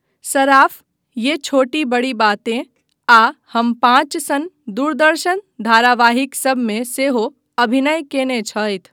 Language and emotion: Maithili, neutral